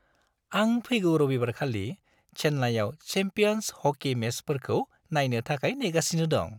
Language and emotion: Bodo, happy